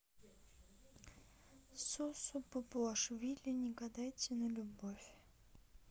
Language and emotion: Russian, neutral